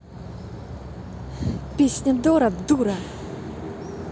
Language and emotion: Russian, angry